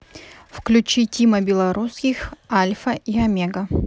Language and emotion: Russian, neutral